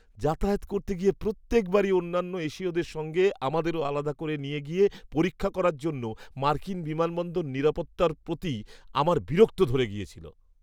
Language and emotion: Bengali, disgusted